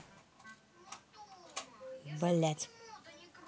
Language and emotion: Russian, neutral